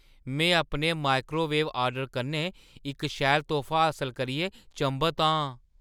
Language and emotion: Dogri, surprised